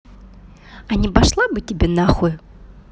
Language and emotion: Russian, angry